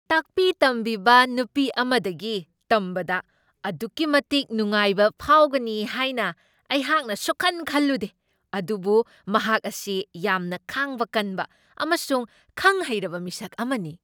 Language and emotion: Manipuri, surprised